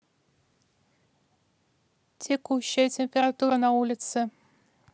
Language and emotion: Russian, neutral